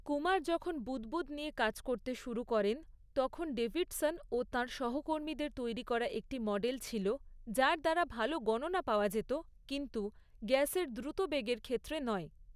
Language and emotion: Bengali, neutral